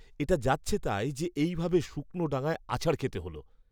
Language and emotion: Bengali, disgusted